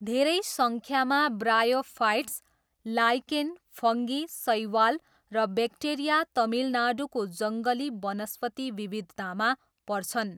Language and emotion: Nepali, neutral